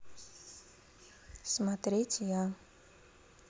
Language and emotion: Russian, neutral